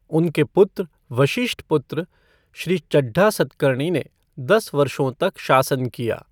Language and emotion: Hindi, neutral